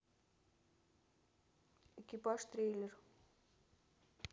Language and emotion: Russian, neutral